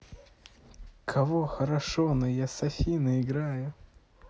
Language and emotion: Russian, neutral